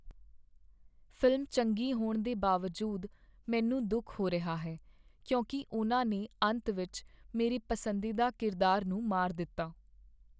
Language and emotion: Punjabi, sad